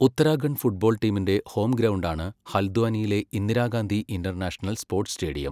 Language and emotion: Malayalam, neutral